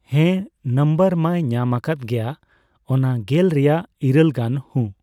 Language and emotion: Santali, neutral